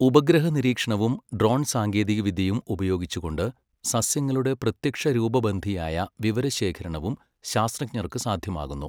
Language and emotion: Malayalam, neutral